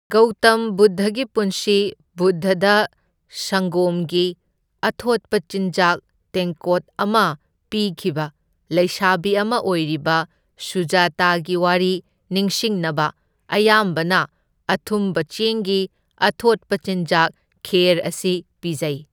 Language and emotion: Manipuri, neutral